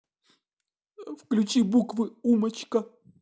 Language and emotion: Russian, sad